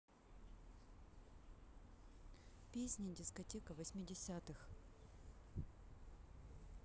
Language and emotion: Russian, neutral